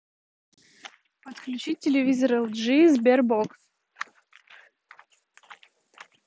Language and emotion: Russian, neutral